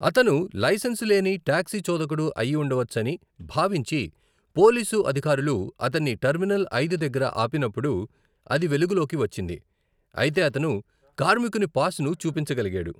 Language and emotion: Telugu, neutral